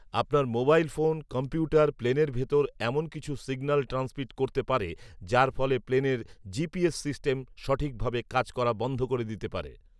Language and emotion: Bengali, neutral